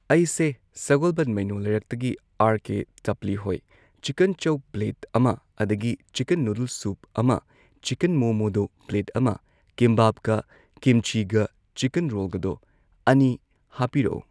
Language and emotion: Manipuri, neutral